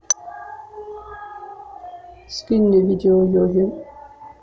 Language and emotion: Russian, neutral